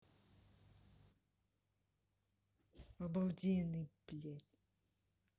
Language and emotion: Russian, sad